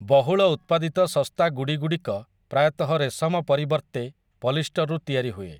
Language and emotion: Odia, neutral